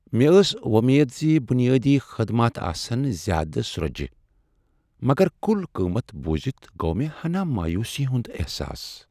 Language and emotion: Kashmiri, sad